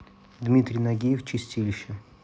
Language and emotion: Russian, neutral